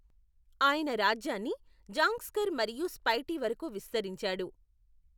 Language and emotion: Telugu, neutral